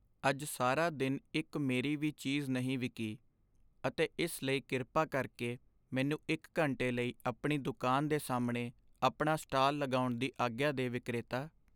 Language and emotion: Punjabi, sad